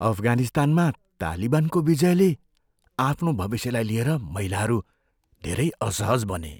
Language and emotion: Nepali, fearful